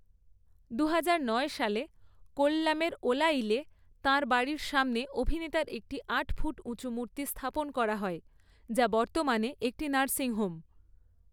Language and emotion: Bengali, neutral